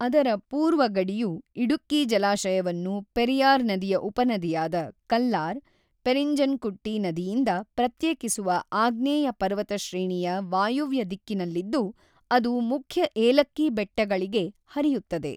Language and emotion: Kannada, neutral